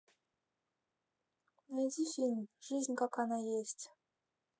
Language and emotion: Russian, neutral